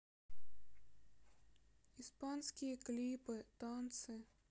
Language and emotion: Russian, sad